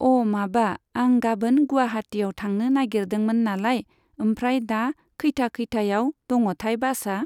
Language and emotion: Bodo, neutral